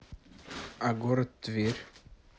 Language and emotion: Russian, neutral